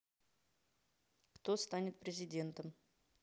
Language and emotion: Russian, neutral